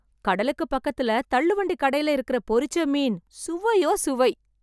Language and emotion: Tamil, happy